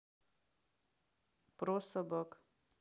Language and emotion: Russian, neutral